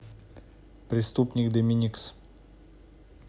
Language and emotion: Russian, neutral